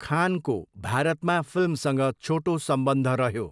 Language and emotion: Nepali, neutral